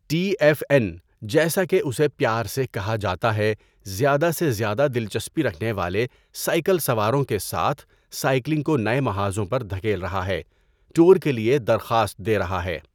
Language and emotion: Urdu, neutral